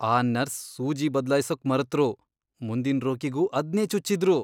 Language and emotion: Kannada, disgusted